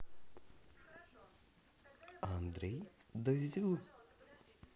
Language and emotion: Russian, positive